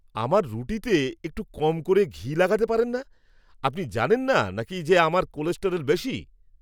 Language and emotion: Bengali, angry